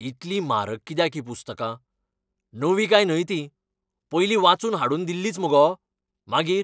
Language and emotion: Goan Konkani, angry